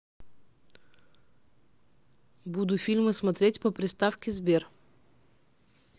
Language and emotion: Russian, neutral